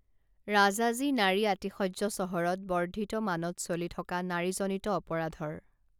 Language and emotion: Assamese, neutral